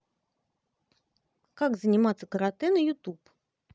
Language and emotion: Russian, positive